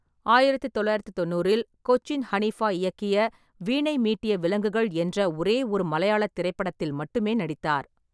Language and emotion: Tamil, neutral